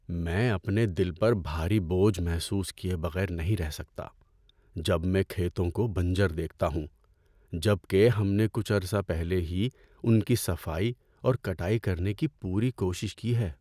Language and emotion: Urdu, sad